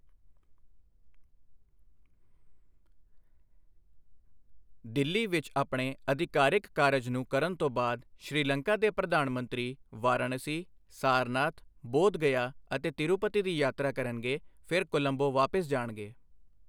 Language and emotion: Punjabi, neutral